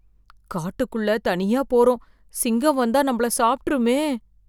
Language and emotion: Tamil, fearful